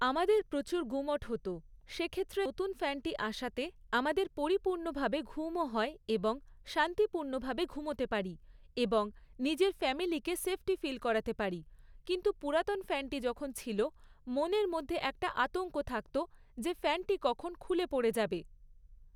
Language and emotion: Bengali, neutral